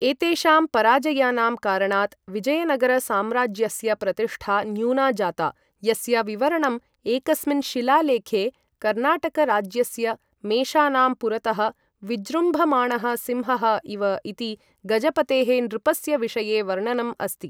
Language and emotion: Sanskrit, neutral